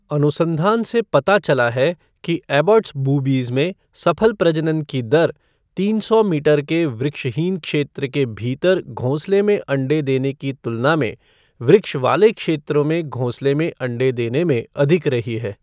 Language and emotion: Hindi, neutral